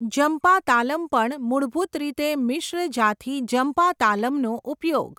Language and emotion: Gujarati, neutral